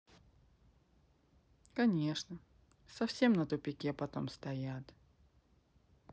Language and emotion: Russian, sad